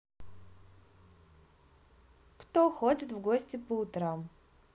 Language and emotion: Russian, positive